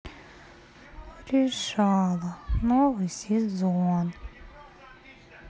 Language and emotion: Russian, sad